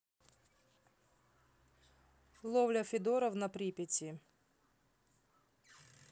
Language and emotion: Russian, neutral